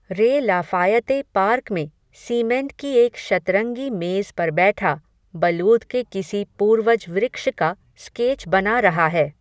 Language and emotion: Hindi, neutral